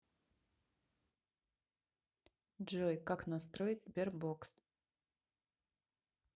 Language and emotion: Russian, neutral